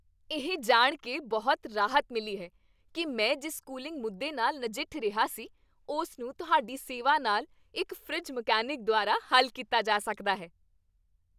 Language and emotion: Punjabi, happy